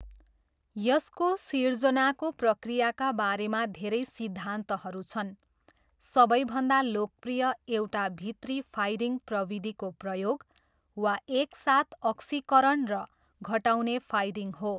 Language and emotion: Nepali, neutral